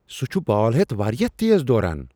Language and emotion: Kashmiri, surprised